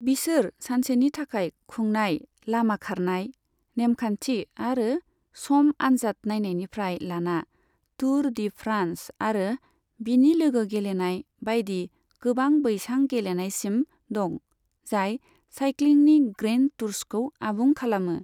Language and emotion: Bodo, neutral